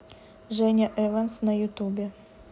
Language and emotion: Russian, neutral